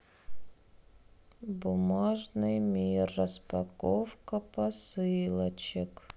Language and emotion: Russian, sad